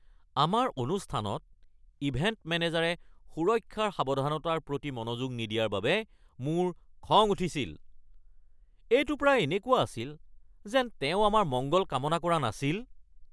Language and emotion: Assamese, angry